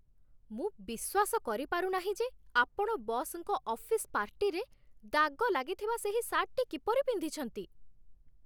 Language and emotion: Odia, disgusted